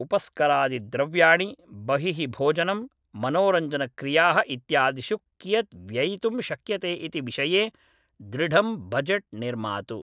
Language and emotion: Sanskrit, neutral